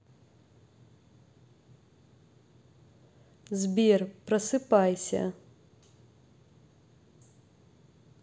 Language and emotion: Russian, neutral